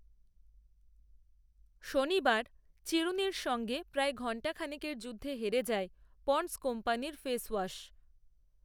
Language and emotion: Bengali, neutral